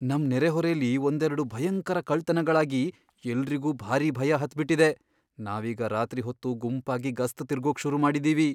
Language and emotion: Kannada, fearful